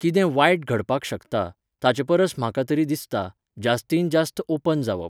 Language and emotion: Goan Konkani, neutral